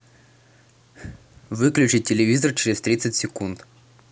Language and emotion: Russian, neutral